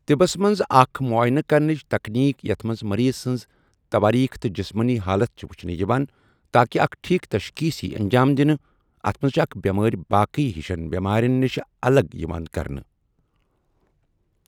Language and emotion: Kashmiri, neutral